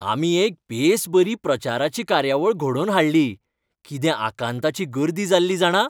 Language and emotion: Goan Konkani, happy